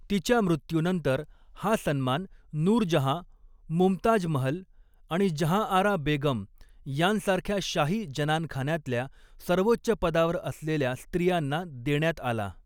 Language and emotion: Marathi, neutral